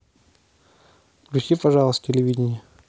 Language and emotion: Russian, neutral